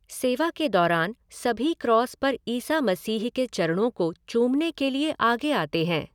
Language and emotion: Hindi, neutral